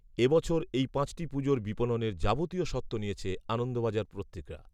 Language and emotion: Bengali, neutral